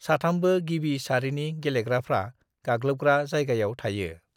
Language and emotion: Bodo, neutral